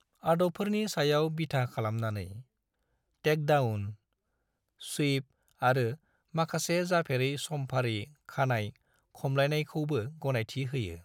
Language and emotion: Bodo, neutral